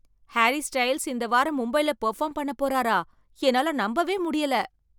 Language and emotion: Tamil, surprised